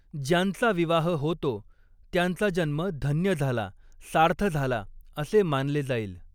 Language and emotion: Marathi, neutral